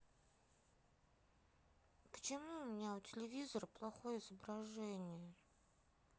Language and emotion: Russian, sad